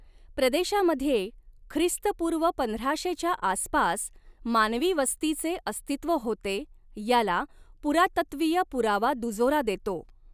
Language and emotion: Marathi, neutral